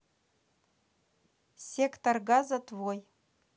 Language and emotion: Russian, neutral